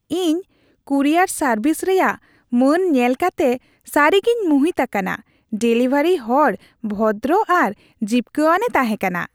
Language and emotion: Santali, happy